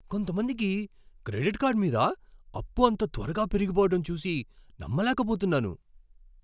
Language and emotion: Telugu, surprised